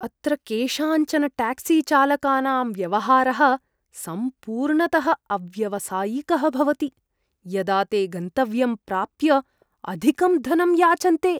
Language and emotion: Sanskrit, disgusted